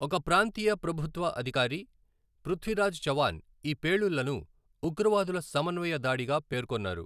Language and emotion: Telugu, neutral